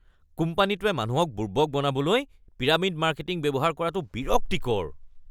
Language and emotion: Assamese, disgusted